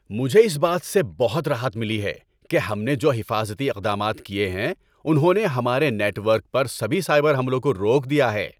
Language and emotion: Urdu, happy